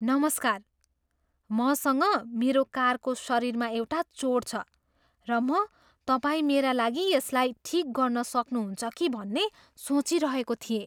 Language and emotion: Nepali, surprised